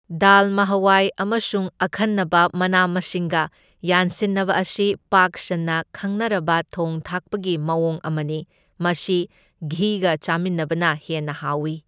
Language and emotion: Manipuri, neutral